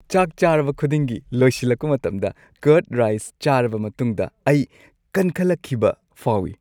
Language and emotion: Manipuri, happy